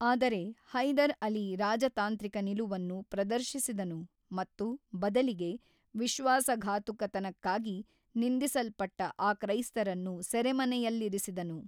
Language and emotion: Kannada, neutral